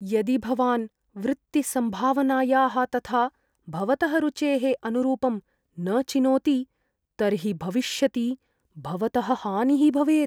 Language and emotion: Sanskrit, fearful